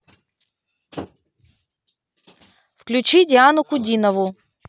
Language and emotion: Russian, neutral